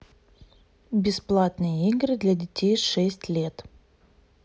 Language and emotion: Russian, neutral